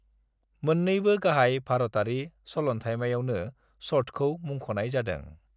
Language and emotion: Bodo, neutral